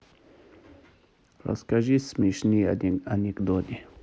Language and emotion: Russian, neutral